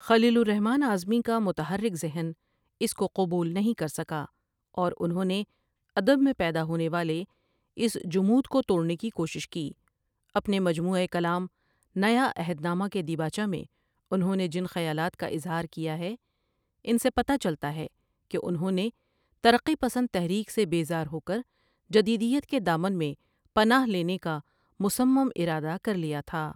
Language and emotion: Urdu, neutral